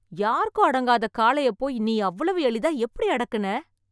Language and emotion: Tamil, surprised